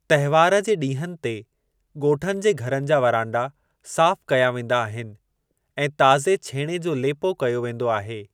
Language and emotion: Sindhi, neutral